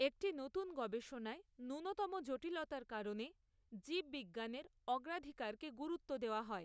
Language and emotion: Bengali, neutral